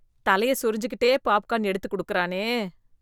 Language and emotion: Tamil, disgusted